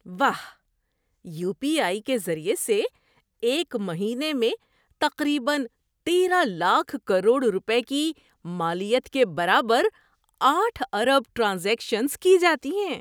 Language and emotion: Urdu, surprised